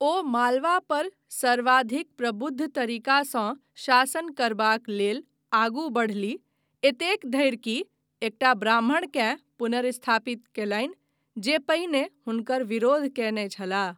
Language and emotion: Maithili, neutral